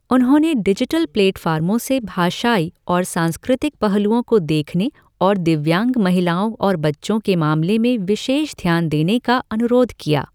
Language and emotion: Hindi, neutral